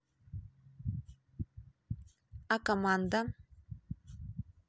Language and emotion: Russian, neutral